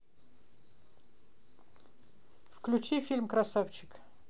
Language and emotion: Russian, neutral